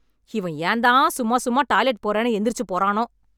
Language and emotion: Tamil, angry